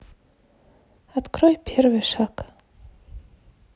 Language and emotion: Russian, neutral